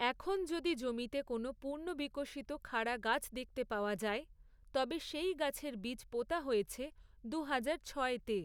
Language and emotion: Bengali, neutral